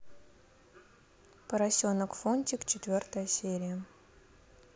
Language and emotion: Russian, neutral